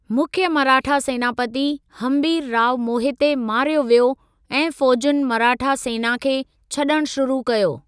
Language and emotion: Sindhi, neutral